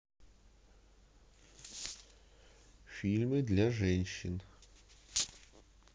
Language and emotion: Russian, neutral